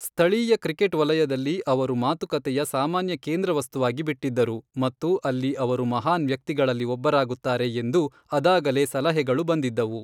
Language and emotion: Kannada, neutral